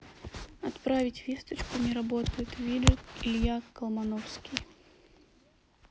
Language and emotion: Russian, neutral